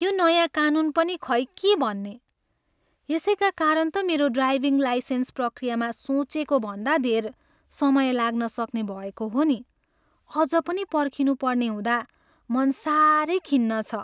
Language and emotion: Nepali, sad